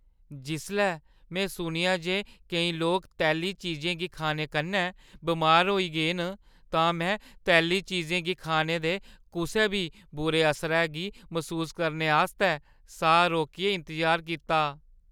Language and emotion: Dogri, fearful